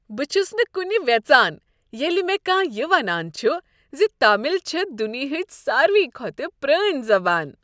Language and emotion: Kashmiri, happy